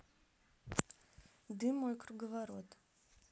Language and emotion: Russian, neutral